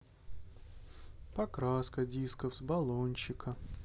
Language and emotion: Russian, sad